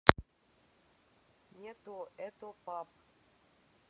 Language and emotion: Russian, neutral